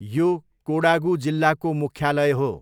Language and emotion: Nepali, neutral